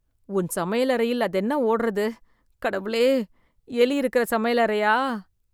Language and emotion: Tamil, disgusted